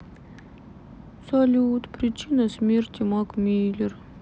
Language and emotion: Russian, sad